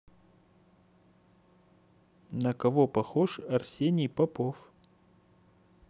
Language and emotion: Russian, neutral